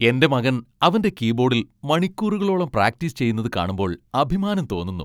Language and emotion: Malayalam, happy